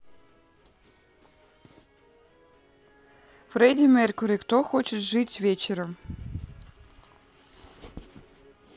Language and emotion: Russian, neutral